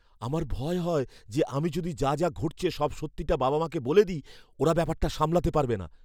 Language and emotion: Bengali, fearful